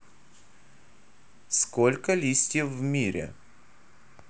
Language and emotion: Russian, neutral